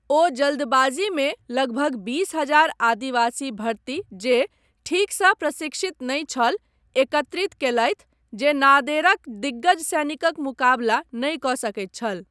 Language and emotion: Maithili, neutral